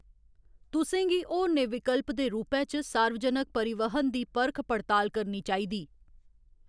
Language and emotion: Dogri, neutral